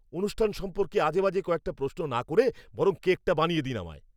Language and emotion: Bengali, angry